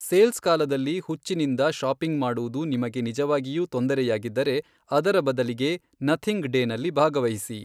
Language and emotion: Kannada, neutral